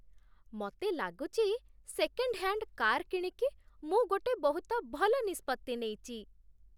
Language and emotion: Odia, happy